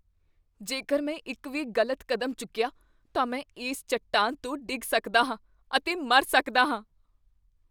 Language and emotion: Punjabi, fearful